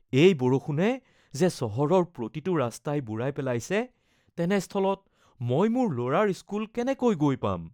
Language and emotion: Assamese, fearful